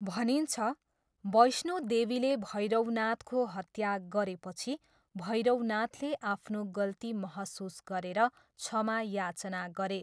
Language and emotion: Nepali, neutral